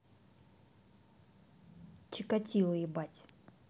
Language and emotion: Russian, neutral